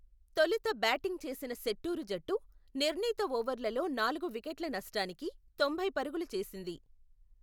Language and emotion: Telugu, neutral